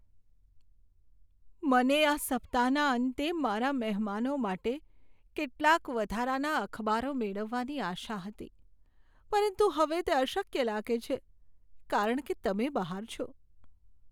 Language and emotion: Gujarati, sad